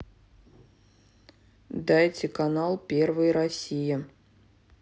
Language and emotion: Russian, neutral